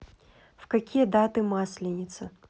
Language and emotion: Russian, neutral